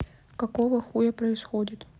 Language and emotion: Russian, neutral